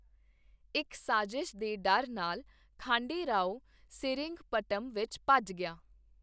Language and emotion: Punjabi, neutral